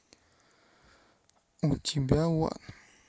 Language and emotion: Russian, neutral